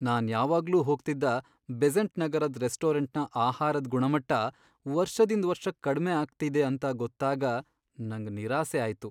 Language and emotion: Kannada, sad